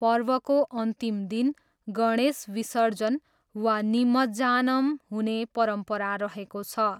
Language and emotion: Nepali, neutral